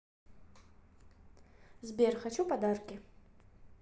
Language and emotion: Russian, neutral